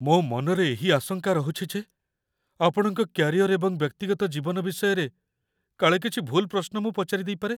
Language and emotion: Odia, fearful